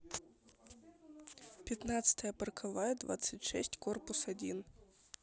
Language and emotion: Russian, neutral